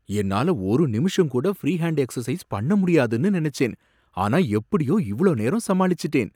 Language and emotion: Tamil, surprised